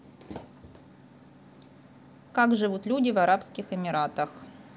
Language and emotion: Russian, neutral